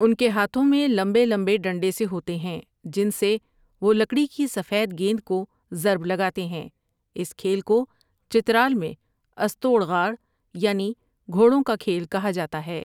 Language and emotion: Urdu, neutral